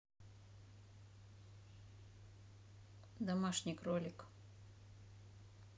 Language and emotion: Russian, neutral